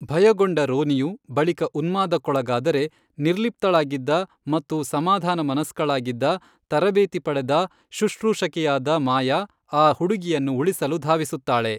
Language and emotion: Kannada, neutral